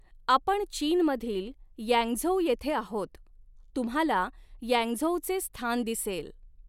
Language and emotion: Marathi, neutral